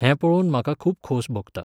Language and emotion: Goan Konkani, neutral